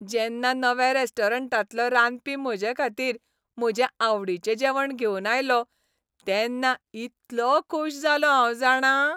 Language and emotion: Goan Konkani, happy